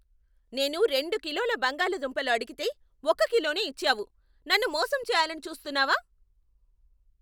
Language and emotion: Telugu, angry